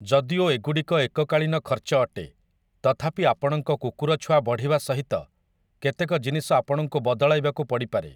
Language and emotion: Odia, neutral